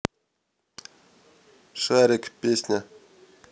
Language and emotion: Russian, neutral